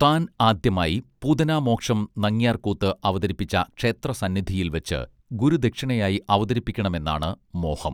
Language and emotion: Malayalam, neutral